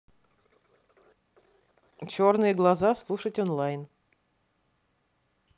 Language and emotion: Russian, neutral